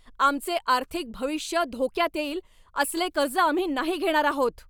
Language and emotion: Marathi, angry